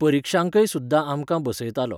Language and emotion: Goan Konkani, neutral